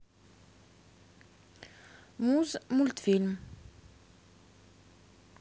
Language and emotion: Russian, neutral